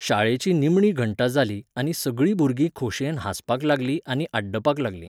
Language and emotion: Goan Konkani, neutral